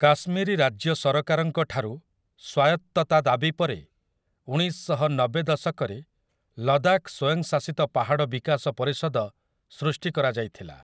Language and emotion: Odia, neutral